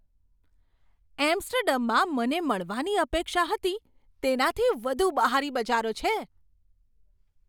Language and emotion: Gujarati, surprised